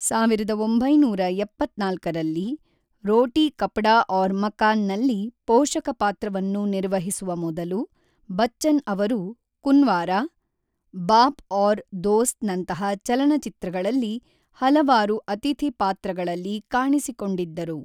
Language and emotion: Kannada, neutral